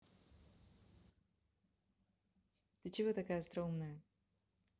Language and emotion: Russian, positive